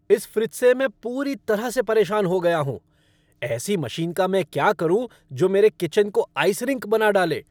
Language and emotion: Hindi, angry